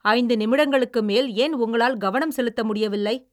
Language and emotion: Tamil, angry